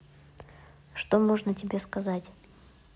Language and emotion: Russian, neutral